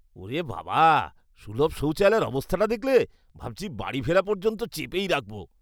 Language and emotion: Bengali, disgusted